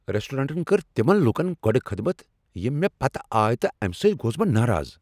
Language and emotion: Kashmiri, angry